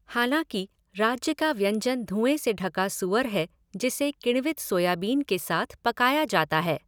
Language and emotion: Hindi, neutral